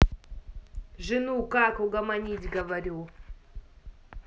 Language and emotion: Russian, angry